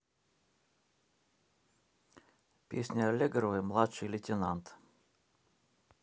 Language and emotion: Russian, neutral